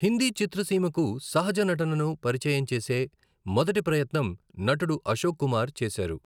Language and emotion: Telugu, neutral